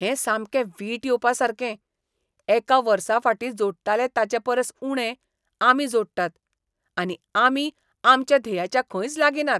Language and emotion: Goan Konkani, disgusted